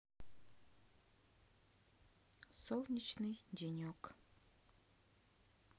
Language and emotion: Russian, neutral